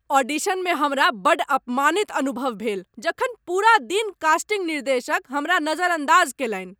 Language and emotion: Maithili, angry